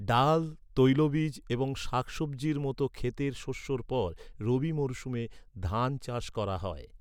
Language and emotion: Bengali, neutral